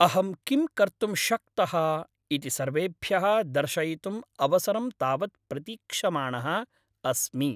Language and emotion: Sanskrit, happy